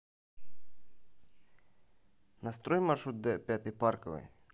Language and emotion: Russian, neutral